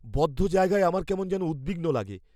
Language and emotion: Bengali, fearful